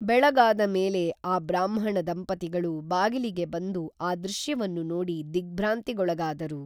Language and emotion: Kannada, neutral